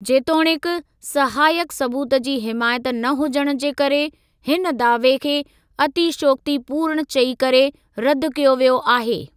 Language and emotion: Sindhi, neutral